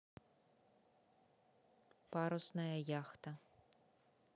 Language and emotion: Russian, neutral